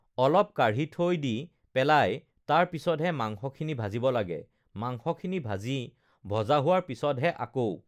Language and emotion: Assamese, neutral